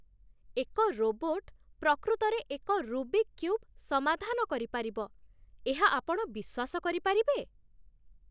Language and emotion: Odia, surprised